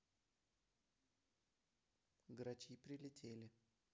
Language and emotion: Russian, neutral